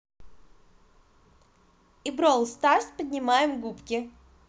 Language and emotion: Russian, positive